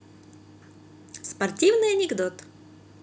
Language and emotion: Russian, positive